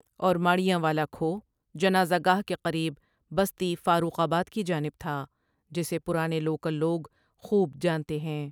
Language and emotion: Urdu, neutral